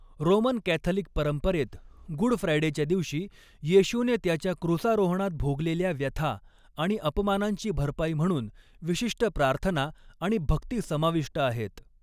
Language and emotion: Marathi, neutral